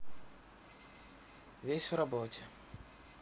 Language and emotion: Russian, sad